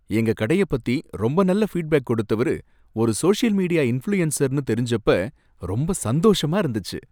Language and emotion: Tamil, happy